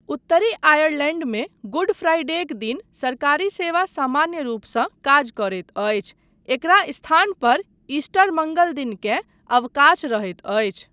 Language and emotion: Maithili, neutral